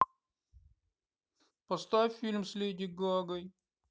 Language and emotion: Russian, sad